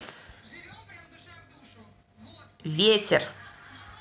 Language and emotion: Russian, neutral